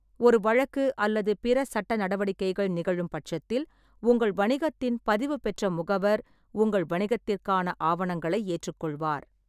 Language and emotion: Tamil, neutral